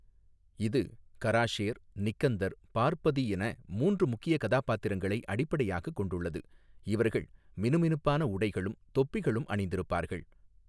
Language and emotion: Tamil, neutral